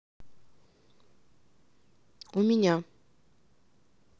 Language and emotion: Russian, neutral